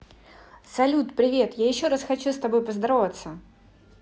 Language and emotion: Russian, positive